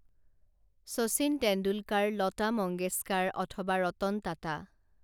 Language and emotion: Assamese, neutral